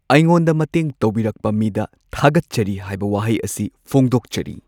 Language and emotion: Manipuri, neutral